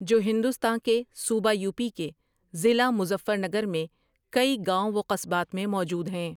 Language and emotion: Urdu, neutral